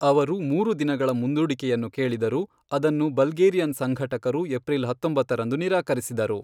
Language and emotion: Kannada, neutral